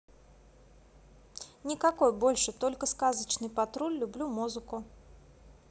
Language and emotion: Russian, neutral